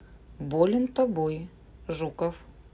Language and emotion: Russian, neutral